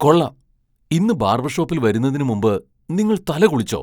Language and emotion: Malayalam, surprised